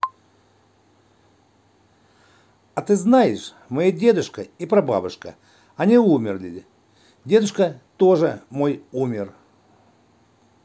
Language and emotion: Russian, neutral